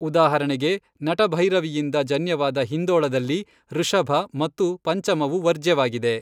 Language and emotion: Kannada, neutral